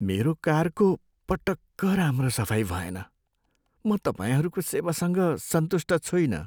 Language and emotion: Nepali, sad